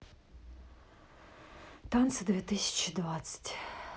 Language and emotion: Russian, sad